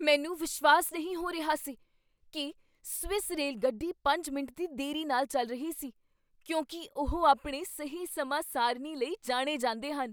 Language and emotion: Punjabi, surprised